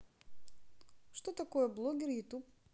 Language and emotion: Russian, neutral